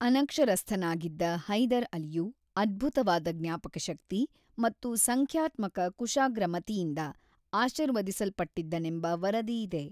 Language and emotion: Kannada, neutral